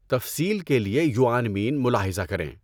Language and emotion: Urdu, neutral